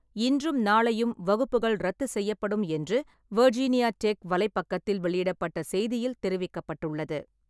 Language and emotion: Tamil, neutral